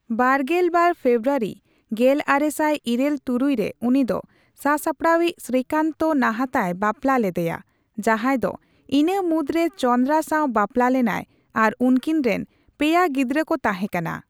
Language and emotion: Santali, neutral